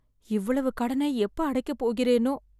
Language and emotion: Tamil, sad